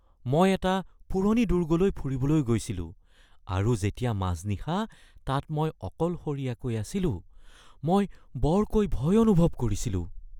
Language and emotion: Assamese, fearful